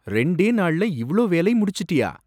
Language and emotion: Tamil, surprised